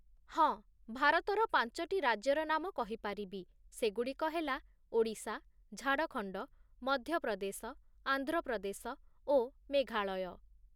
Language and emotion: Odia, neutral